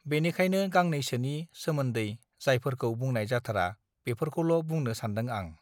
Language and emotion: Bodo, neutral